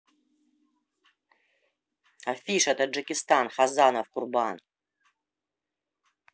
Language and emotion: Russian, angry